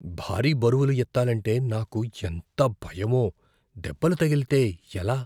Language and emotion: Telugu, fearful